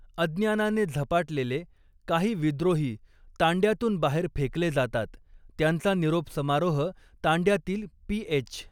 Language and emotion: Marathi, neutral